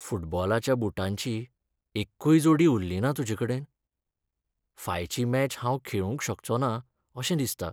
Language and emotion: Goan Konkani, sad